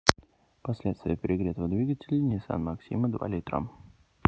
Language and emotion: Russian, neutral